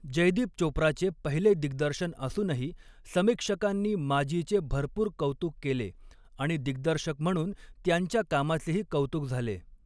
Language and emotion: Marathi, neutral